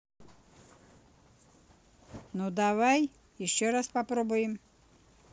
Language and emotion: Russian, neutral